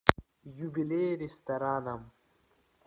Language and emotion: Russian, neutral